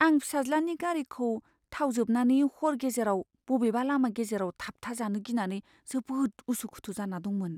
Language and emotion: Bodo, fearful